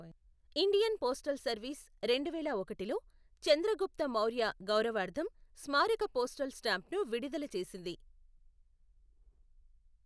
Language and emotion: Telugu, neutral